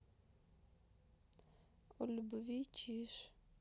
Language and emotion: Russian, sad